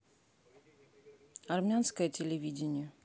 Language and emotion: Russian, neutral